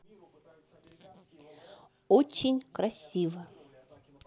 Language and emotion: Russian, positive